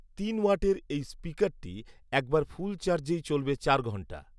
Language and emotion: Bengali, neutral